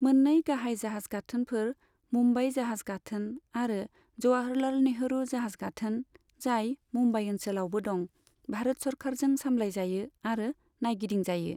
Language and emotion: Bodo, neutral